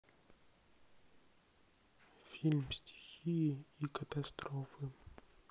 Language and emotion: Russian, sad